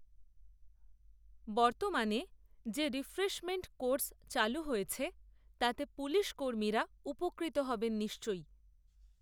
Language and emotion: Bengali, neutral